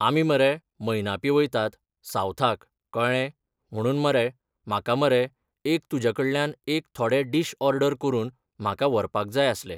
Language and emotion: Goan Konkani, neutral